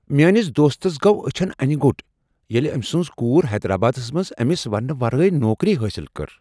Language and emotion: Kashmiri, surprised